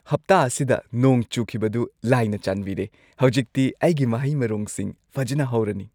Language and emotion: Manipuri, happy